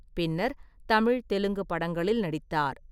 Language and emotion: Tamil, neutral